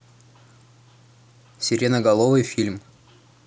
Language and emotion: Russian, neutral